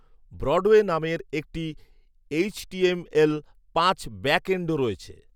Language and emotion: Bengali, neutral